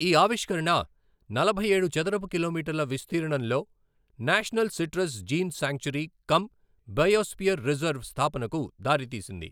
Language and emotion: Telugu, neutral